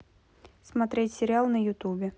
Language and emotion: Russian, neutral